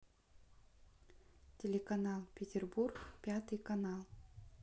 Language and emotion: Russian, neutral